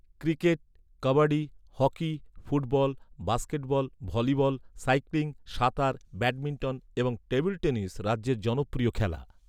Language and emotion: Bengali, neutral